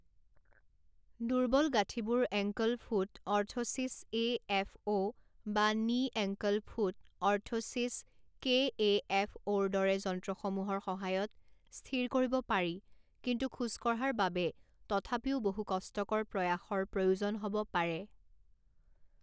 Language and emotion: Assamese, neutral